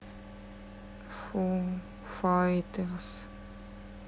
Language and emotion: Russian, sad